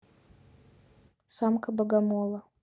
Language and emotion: Russian, neutral